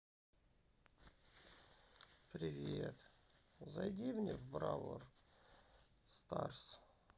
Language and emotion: Russian, sad